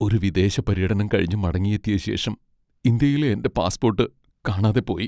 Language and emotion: Malayalam, sad